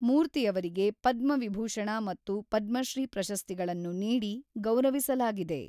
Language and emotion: Kannada, neutral